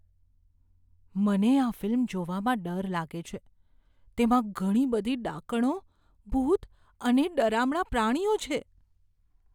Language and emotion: Gujarati, fearful